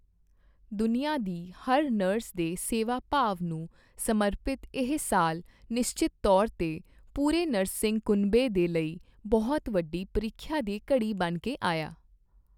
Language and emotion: Punjabi, neutral